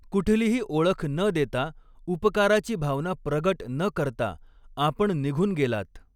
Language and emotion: Marathi, neutral